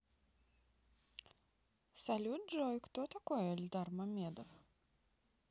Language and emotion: Russian, neutral